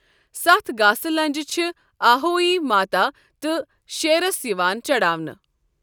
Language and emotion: Kashmiri, neutral